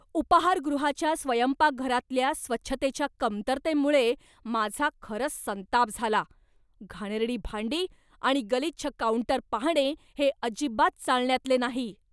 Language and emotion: Marathi, angry